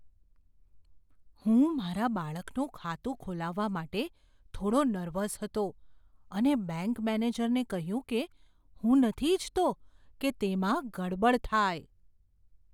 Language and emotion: Gujarati, fearful